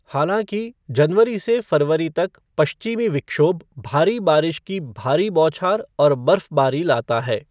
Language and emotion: Hindi, neutral